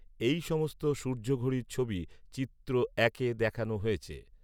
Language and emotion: Bengali, neutral